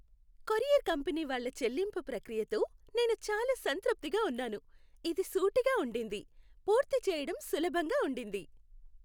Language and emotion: Telugu, happy